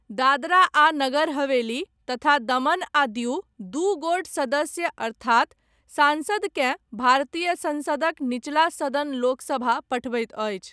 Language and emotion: Maithili, neutral